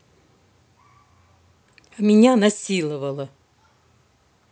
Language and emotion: Russian, angry